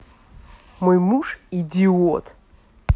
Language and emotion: Russian, angry